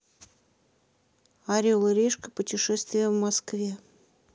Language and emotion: Russian, neutral